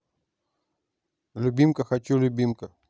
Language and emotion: Russian, neutral